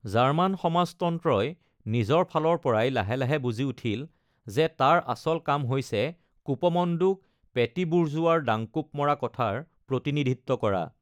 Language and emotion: Assamese, neutral